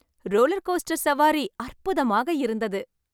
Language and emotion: Tamil, happy